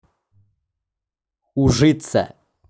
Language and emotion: Russian, neutral